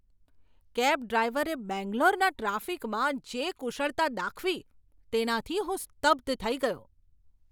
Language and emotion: Gujarati, surprised